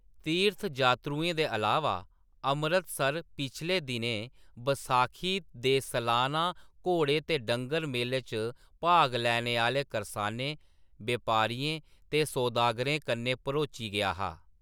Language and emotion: Dogri, neutral